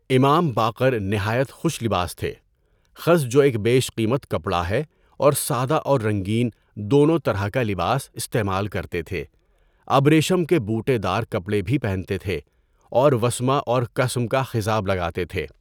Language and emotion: Urdu, neutral